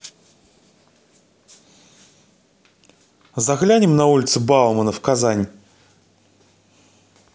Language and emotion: Russian, neutral